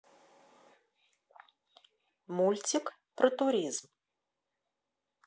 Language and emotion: Russian, neutral